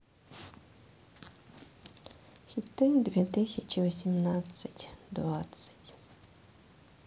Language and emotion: Russian, sad